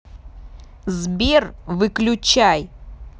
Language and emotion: Russian, angry